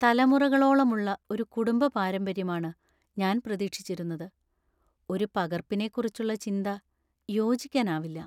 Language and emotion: Malayalam, sad